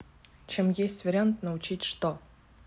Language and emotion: Russian, neutral